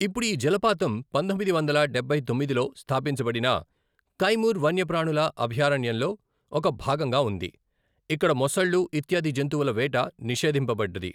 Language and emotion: Telugu, neutral